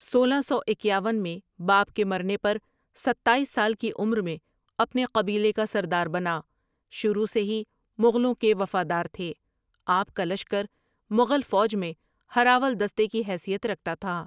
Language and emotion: Urdu, neutral